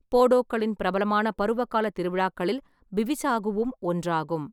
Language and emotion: Tamil, neutral